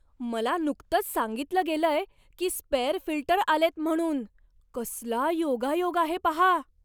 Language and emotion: Marathi, surprised